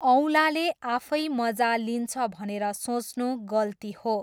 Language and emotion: Nepali, neutral